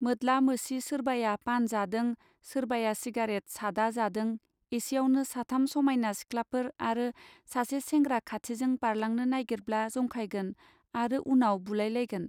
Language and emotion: Bodo, neutral